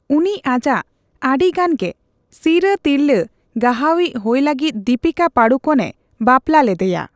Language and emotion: Santali, neutral